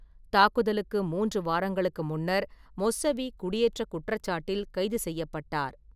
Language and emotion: Tamil, neutral